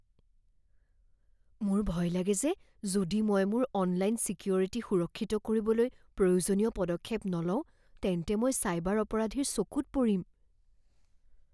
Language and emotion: Assamese, fearful